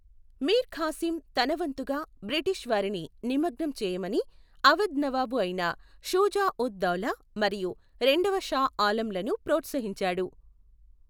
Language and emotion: Telugu, neutral